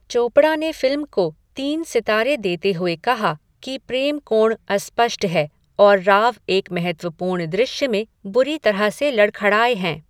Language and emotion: Hindi, neutral